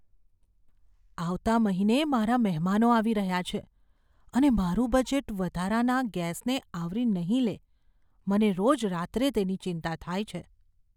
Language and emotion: Gujarati, fearful